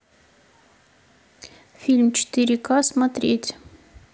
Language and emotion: Russian, neutral